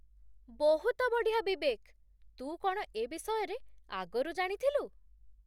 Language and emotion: Odia, surprised